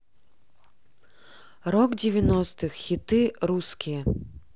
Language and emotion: Russian, neutral